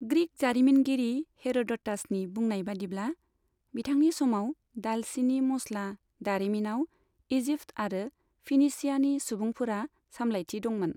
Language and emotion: Bodo, neutral